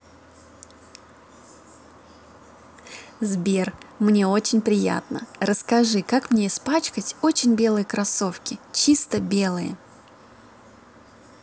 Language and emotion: Russian, positive